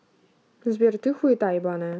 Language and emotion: Russian, angry